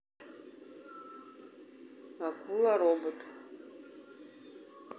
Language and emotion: Russian, neutral